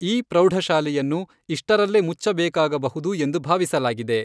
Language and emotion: Kannada, neutral